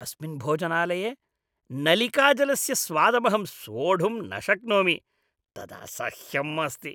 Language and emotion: Sanskrit, disgusted